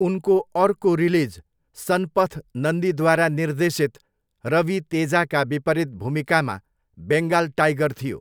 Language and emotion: Nepali, neutral